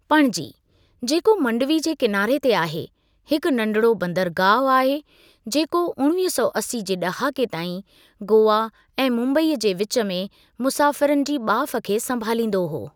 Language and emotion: Sindhi, neutral